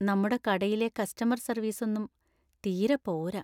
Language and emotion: Malayalam, sad